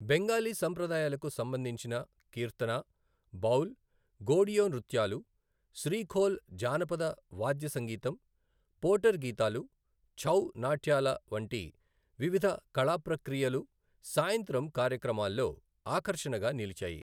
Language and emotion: Telugu, neutral